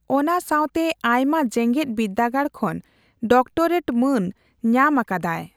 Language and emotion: Santali, neutral